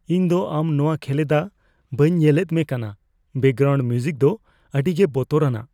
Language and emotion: Santali, fearful